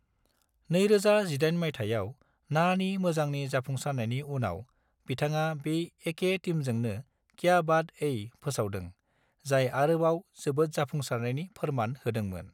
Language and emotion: Bodo, neutral